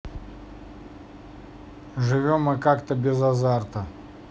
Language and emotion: Russian, neutral